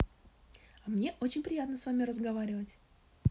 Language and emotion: Russian, positive